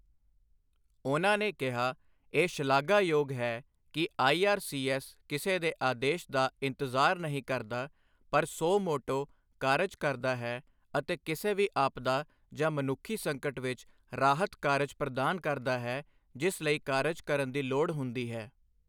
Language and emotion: Punjabi, neutral